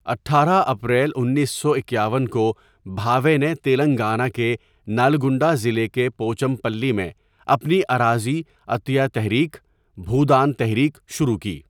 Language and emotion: Urdu, neutral